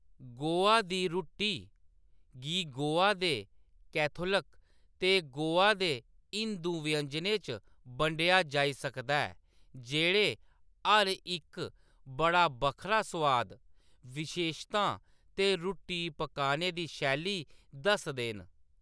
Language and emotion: Dogri, neutral